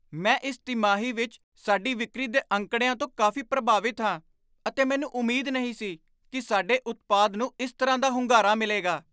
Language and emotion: Punjabi, surprised